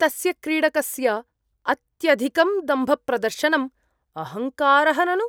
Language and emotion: Sanskrit, disgusted